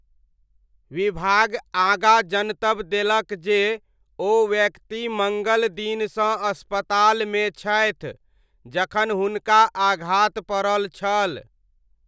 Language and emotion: Maithili, neutral